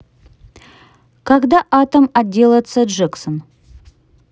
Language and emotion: Russian, neutral